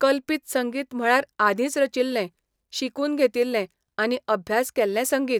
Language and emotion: Goan Konkani, neutral